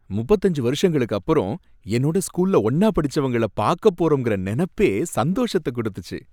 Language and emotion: Tamil, happy